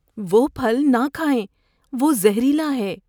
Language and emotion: Urdu, fearful